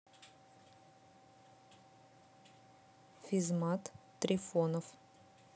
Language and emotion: Russian, neutral